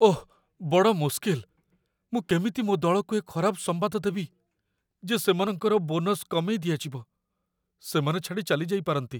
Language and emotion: Odia, fearful